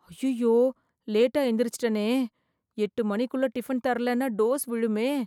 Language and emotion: Tamil, fearful